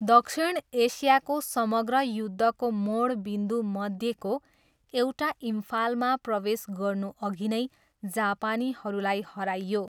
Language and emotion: Nepali, neutral